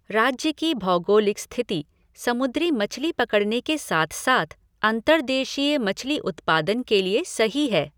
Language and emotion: Hindi, neutral